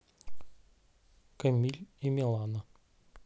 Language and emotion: Russian, neutral